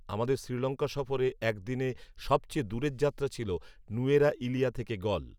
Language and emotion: Bengali, neutral